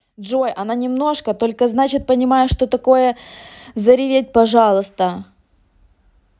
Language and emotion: Russian, angry